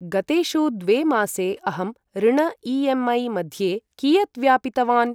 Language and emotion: Sanskrit, neutral